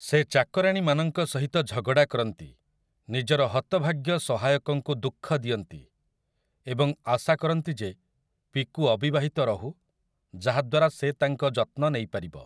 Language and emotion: Odia, neutral